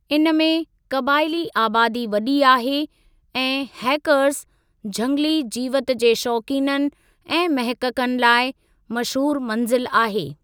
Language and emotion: Sindhi, neutral